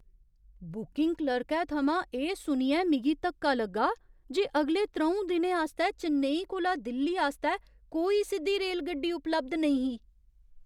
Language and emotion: Dogri, surprised